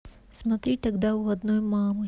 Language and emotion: Russian, neutral